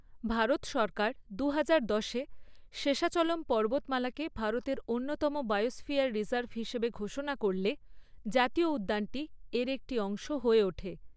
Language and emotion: Bengali, neutral